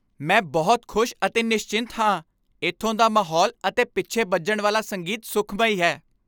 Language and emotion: Punjabi, happy